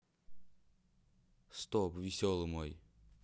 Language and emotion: Russian, neutral